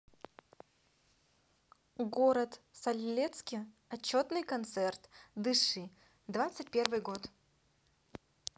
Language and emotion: Russian, positive